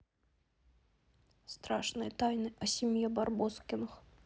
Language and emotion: Russian, neutral